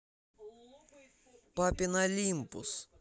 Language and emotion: Russian, neutral